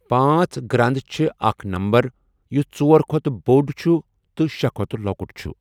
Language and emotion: Kashmiri, neutral